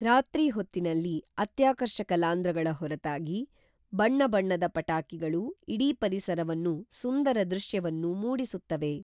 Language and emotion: Kannada, neutral